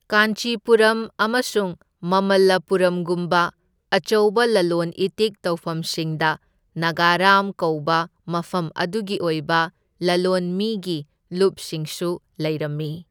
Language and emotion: Manipuri, neutral